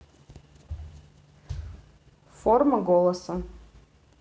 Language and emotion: Russian, neutral